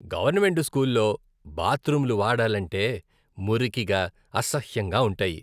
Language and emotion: Telugu, disgusted